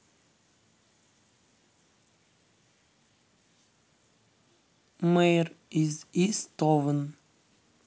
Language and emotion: Russian, neutral